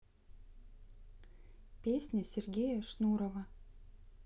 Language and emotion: Russian, neutral